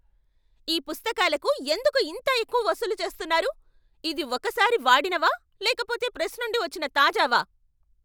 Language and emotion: Telugu, angry